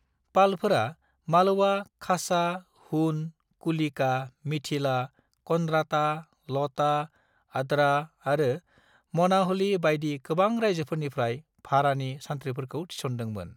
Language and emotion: Bodo, neutral